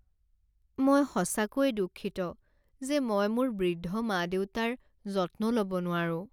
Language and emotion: Assamese, sad